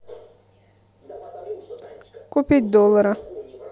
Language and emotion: Russian, neutral